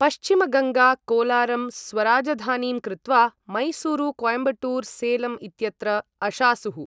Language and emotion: Sanskrit, neutral